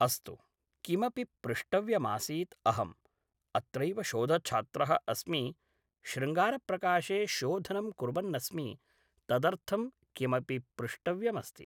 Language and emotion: Sanskrit, neutral